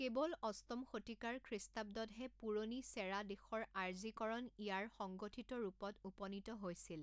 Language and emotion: Assamese, neutral